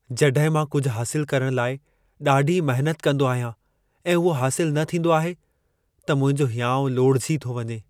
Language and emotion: Sindhi, sad